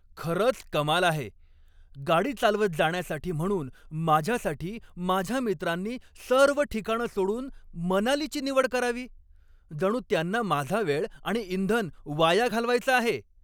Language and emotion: Marathi, angry